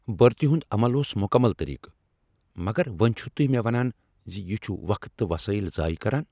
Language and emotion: Kashmiri, angry